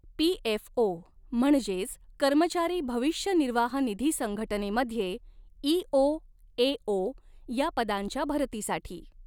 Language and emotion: Marathi, neutral